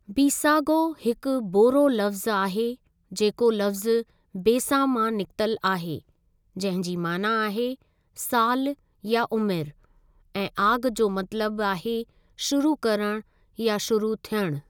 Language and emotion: Sindhi, neutral